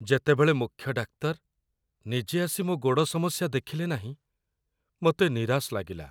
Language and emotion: Odia, sad